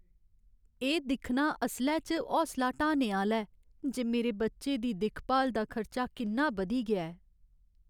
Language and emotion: Dogri, sad